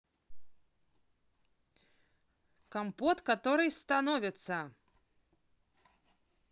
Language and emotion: Russian, positive